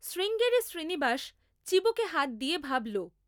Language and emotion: Bengali, neutral